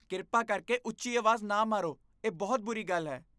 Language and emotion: Punjabi, disgusted